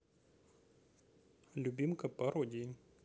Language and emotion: Russian, neutral